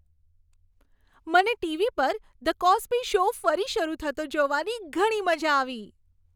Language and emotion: Gujarati, happy